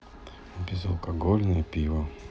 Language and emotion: Russian, sad